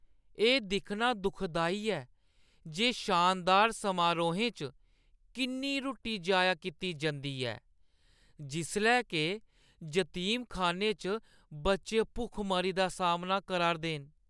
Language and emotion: Dogri, sad